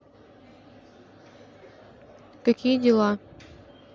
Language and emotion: Russian, neutral